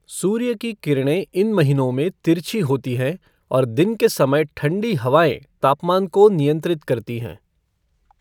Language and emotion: Hindi, neutral